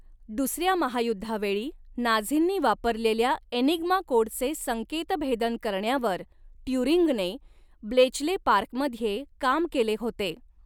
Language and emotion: Marathi, neutral